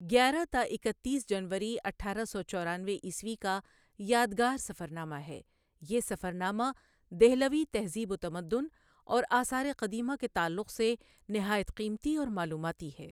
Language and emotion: Urdu, neutral